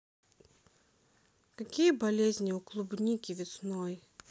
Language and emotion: Russian, sad